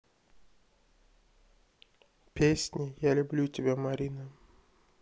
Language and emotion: Russian, sad